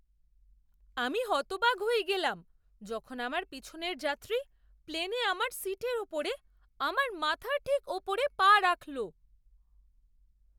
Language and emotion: Bengali, surprised